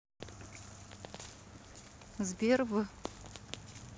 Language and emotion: Russian, neutral